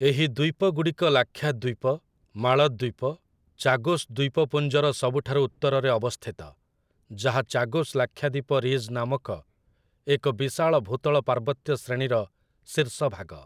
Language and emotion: Odia, neutral